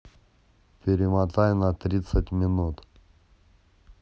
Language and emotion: Russian, neutral